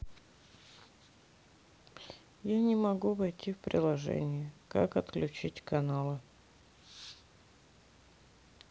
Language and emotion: Russian, neutral